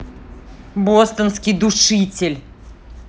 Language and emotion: Russian, angry